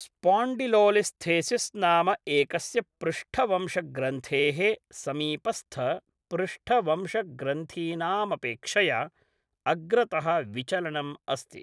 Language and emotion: Sanskrit, neutral